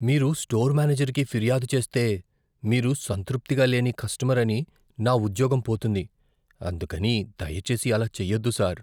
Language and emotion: Telugu, fearful